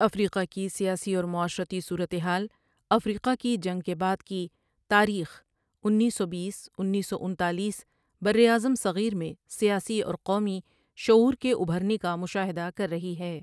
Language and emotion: Urdu, neutral